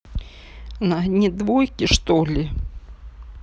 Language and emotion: Russian, sad